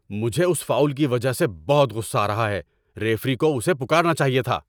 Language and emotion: Urdu, angry